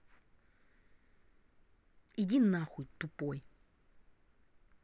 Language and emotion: Russian, angry